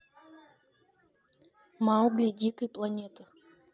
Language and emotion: Russian, neutral